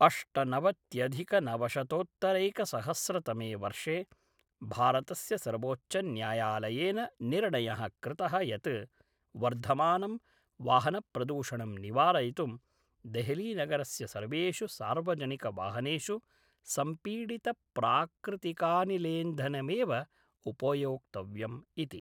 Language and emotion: Sanskrit, neutral